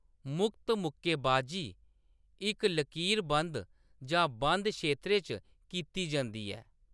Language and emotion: Dogri, neutral